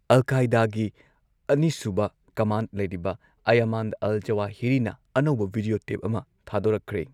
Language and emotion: Manipuri, neutral